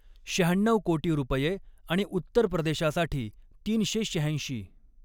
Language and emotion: Marathi, neutral